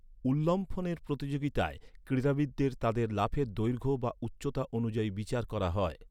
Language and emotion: Bengali, neutral